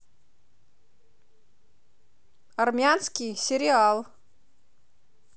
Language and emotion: Russian, positive